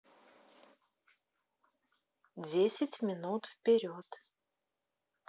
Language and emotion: Russian, neutral